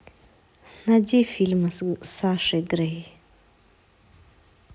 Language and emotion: Russian, neutral